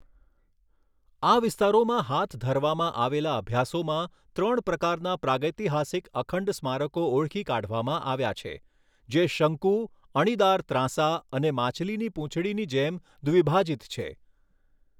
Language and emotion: Gujarati, neutral